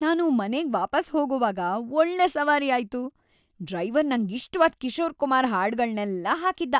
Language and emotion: Kannada, happy